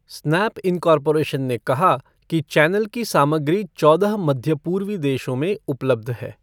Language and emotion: Hindi, neutral